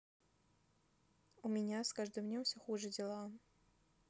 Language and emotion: Russian, sad